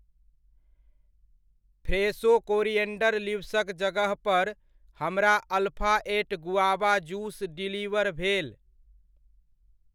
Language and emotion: Maithili, neutral